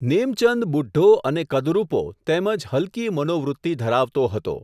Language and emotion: Gujarati, neutral